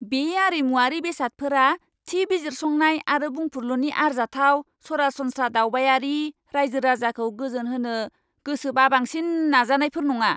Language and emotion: Bodo, angry